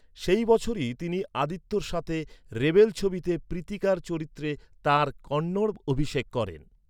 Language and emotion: Bengali, neutral